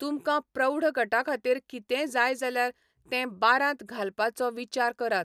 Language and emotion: Goan Konkani, neutral